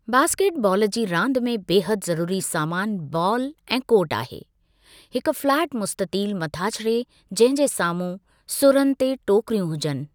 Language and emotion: Sindhi, neutral